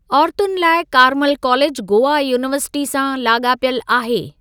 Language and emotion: Sindhi, neutral